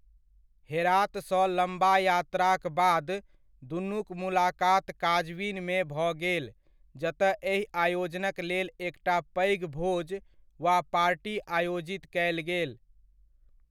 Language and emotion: Maithili, neutral